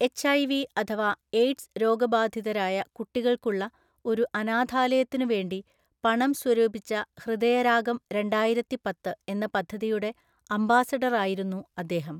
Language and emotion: Malayalam, neutral